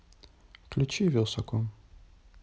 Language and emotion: Russian, neutral